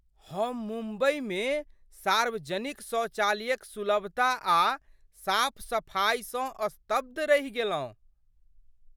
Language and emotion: Maithili, surprised